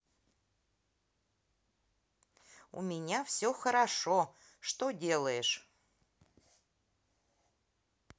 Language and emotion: Russian, positive